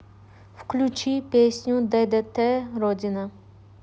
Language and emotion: Russian, neutral